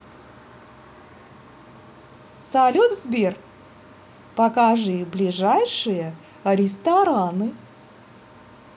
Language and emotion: Russian, positive